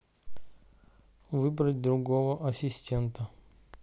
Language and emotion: Russian, neutral